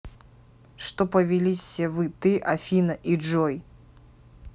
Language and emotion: Russian, angry